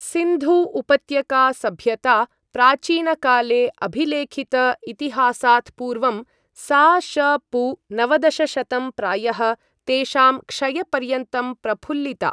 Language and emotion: Sanskrit, neutral